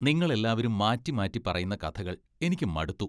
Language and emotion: Malayalam, disgusted